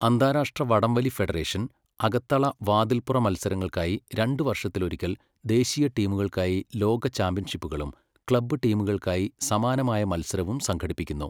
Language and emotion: Malayalam, neutral